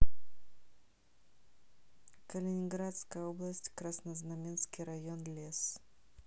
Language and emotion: Russian, neutral